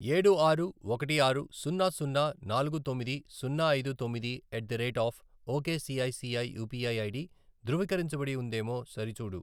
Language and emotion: Telugu, neutral